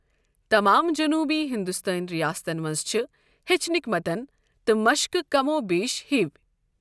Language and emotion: Kashmiri, neutral